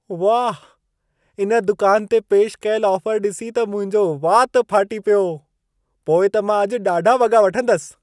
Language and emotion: Sindhi, surprised